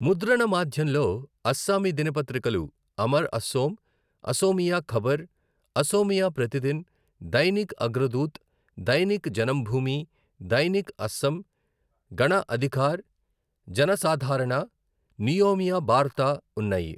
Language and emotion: Telugu, neutral